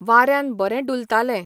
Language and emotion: Goan Konkani, neutral